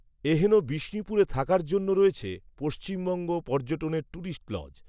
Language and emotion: Bengali, neutral